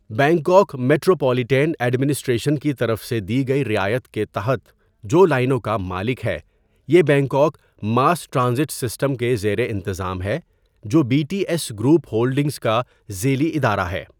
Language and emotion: Urdu, neutral